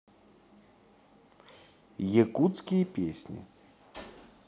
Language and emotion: Russian, neutral